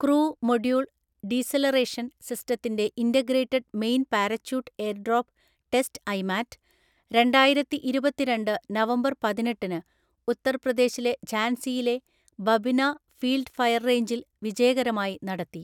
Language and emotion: Malayalam, neutral